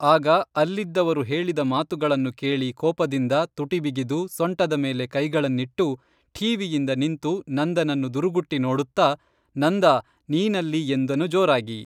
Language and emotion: Kannada, neutral